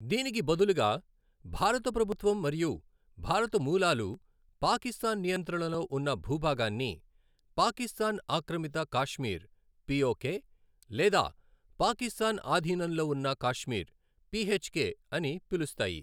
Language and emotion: Telugu, neutral